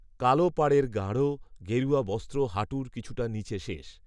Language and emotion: Bengali, neutral